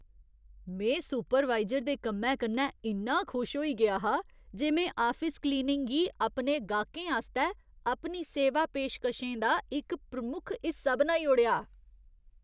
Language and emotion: Dogri, surprised